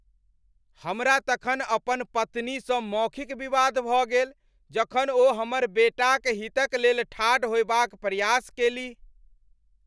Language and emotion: Maithili, angry